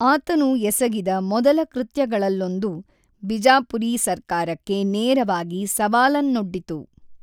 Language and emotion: Kannada, neutral